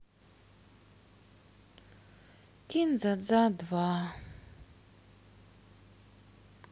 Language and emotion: Russian, sad